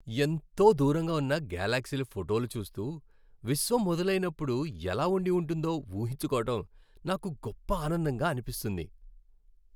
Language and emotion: Telugu, happy